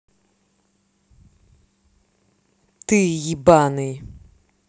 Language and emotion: Russian, angry